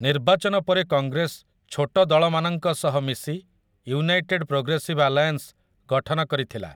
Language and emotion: Odia, neutral